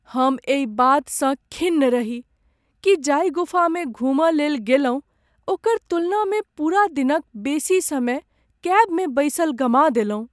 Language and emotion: Maithili, sad